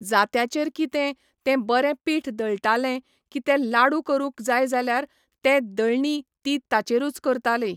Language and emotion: Goan Konkani, neutral